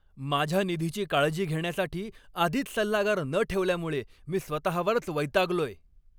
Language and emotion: Marathi, angry